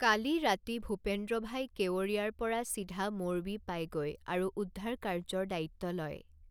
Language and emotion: Assamese, neutral